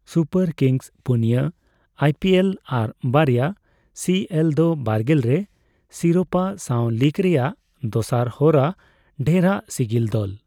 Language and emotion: Santali, neutral